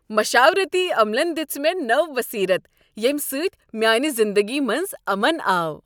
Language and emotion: Kashmiri, happy